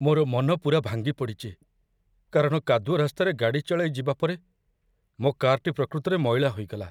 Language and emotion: Odia, sad